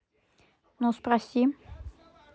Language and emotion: Russian, neutral